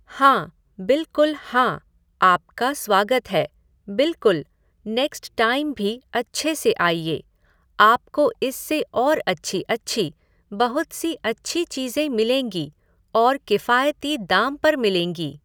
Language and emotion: Hindi, neutral